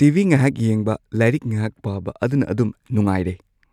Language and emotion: Manipuri, neutral